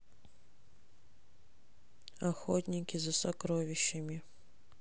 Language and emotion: Russian, sad